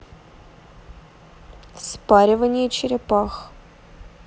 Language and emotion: Russian, neutral